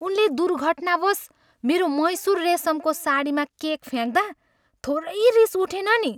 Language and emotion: Nepali, angry